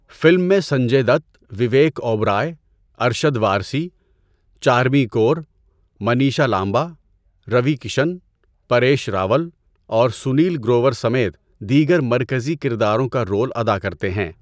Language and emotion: Urdu, neutral